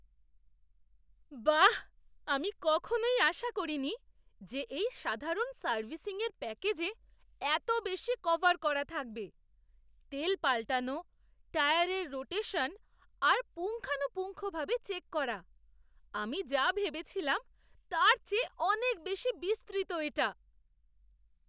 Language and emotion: Bengali, surprised